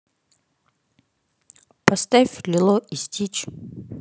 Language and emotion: Russian, neutral